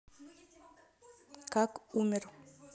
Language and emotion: Russian, neutral